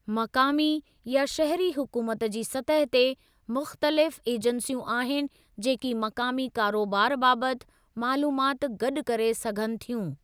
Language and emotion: Sindhi, neutral